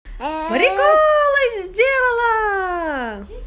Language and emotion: Russian, positive